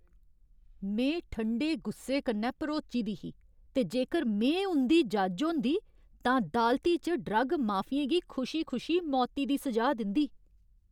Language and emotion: Dogri, angry